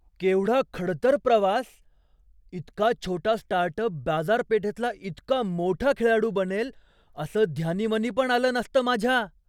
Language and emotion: Marathi, surprised